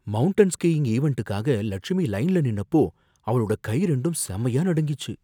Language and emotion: Tamil, fearful